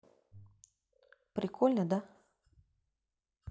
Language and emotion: Russian, neutral